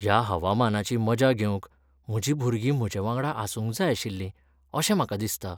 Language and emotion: Goan Konkani, sad